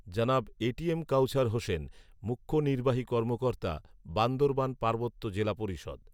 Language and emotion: Bengali, neutral